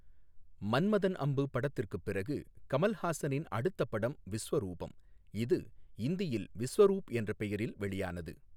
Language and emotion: Tamil, neutral